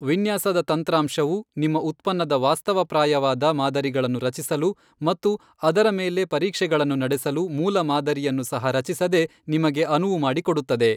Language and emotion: Kannada, neutral